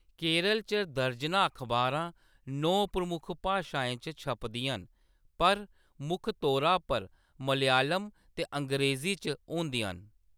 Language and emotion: Dogri, neutral